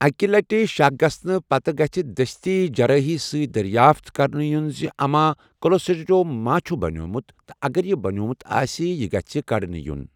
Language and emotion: Kashmiri, neutral